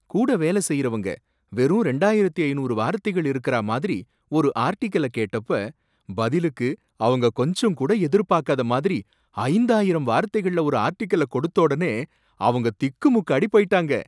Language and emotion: Tamil, surprised